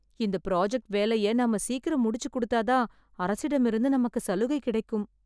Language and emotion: Tamil, sad